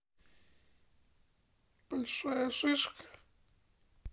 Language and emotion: Russian, sad